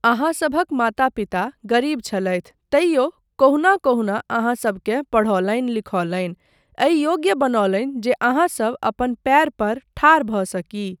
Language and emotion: Maithili, neutral